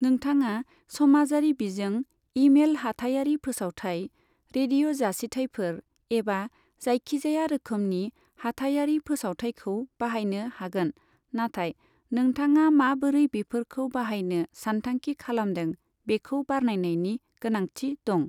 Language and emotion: Bodo, neutral